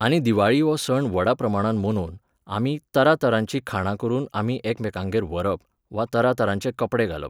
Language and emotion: Goan Konkani, neutral